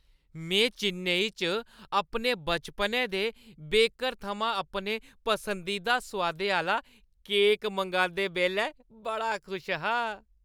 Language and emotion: Dogri, happy